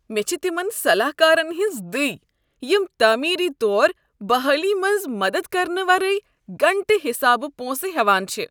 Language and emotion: Kashmiri, disgusted